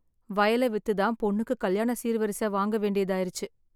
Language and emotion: Tamil, sad